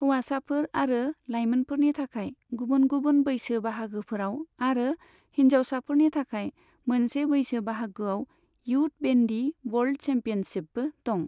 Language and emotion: Bodo, neutral